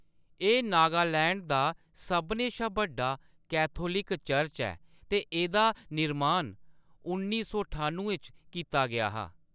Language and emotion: Dogri, neutral